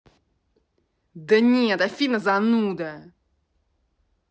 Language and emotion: Russian, angry